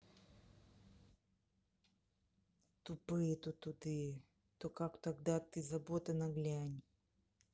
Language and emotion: Russian, angry